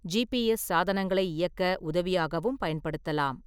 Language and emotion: Tamil, neutral